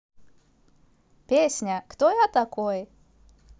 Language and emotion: Russian, positive